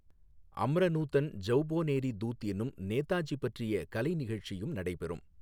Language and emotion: Tamil, neutral